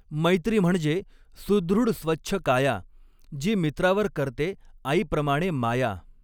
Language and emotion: Marathi, neutral